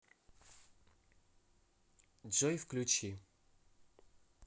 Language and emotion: Russian, neutral